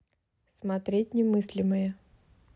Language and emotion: Russian, neutral